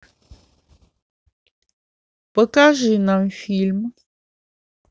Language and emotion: Russian, neutral